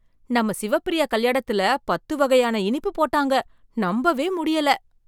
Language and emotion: Tamil, surprised